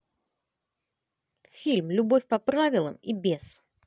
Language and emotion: Russian, positive